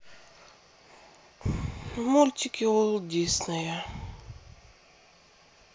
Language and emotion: Russian, sad